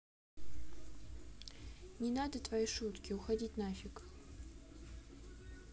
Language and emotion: Russian, neutral